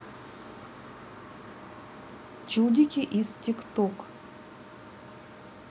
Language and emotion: Russian, neutral